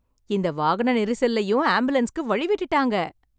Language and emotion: Tamil, happy